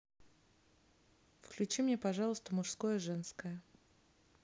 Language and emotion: Russian, neutral